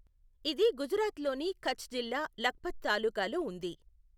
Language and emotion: Telugu, neutral